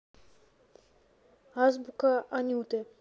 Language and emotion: Russian, neutral